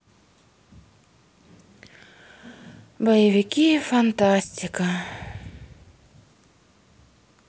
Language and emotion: Russian, sad